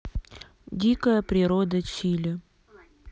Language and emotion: Russian, neutral